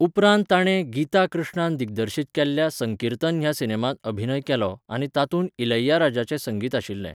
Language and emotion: Goan Konkani, neutral